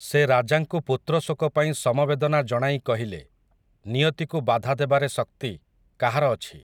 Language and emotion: Odia, neutral